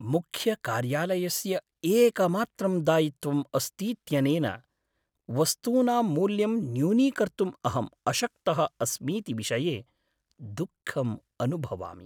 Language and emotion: Sanskrit, sad